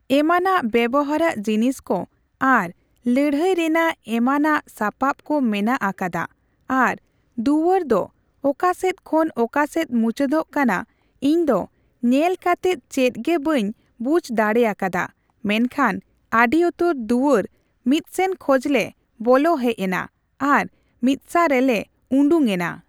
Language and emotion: Santali, neutral